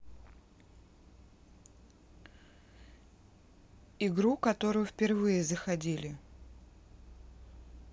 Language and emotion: Russian, neutral